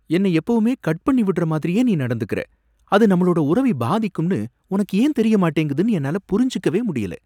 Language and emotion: Tamil, surprised